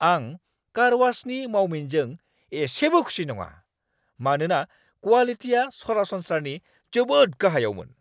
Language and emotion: Bodo, angry